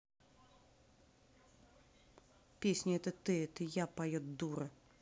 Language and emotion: Russian, angry